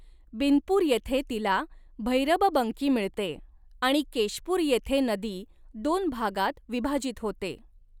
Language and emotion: Marathi, neutral